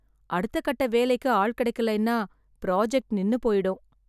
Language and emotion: Tamil, sad